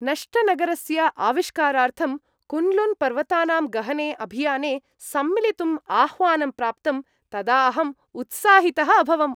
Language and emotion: Sanskrit, happy